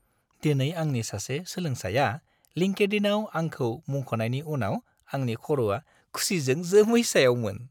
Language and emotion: Bodo, happy